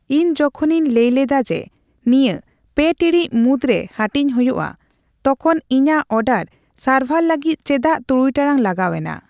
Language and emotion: Santali, neutral